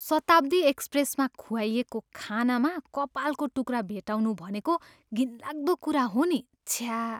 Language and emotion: Nepali, disgusted